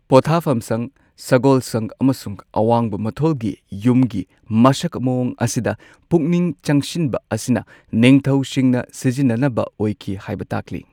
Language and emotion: Manipuri, neutral